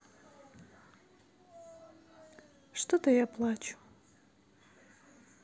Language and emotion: Russian, sad